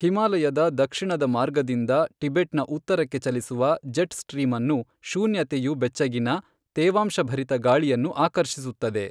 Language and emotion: Kannada, neutral